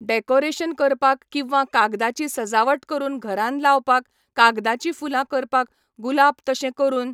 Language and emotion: Goan Konkani, neutral